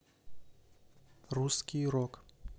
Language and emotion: Russian, neutral